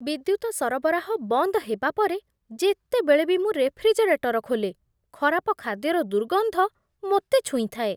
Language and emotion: Odia, disgusted